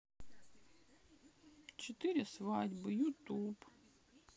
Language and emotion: Russian, sad